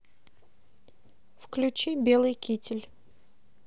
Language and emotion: Russian, neutral